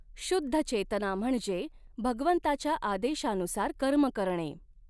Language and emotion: Marathi, neutral